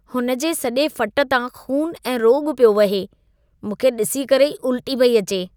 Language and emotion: Sindhi, disgusted